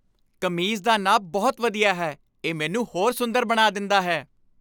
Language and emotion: Punjabi, happy